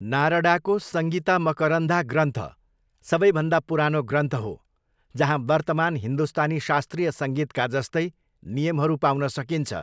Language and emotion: Nepali, neutral